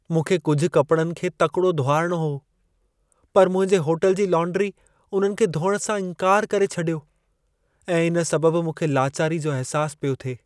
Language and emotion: Sindhi, sad